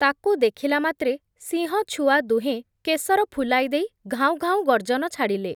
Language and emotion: Odia, neutral